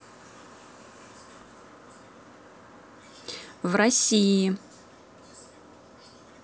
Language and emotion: Russian, neutral